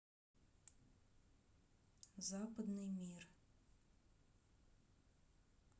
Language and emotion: Russian, neutral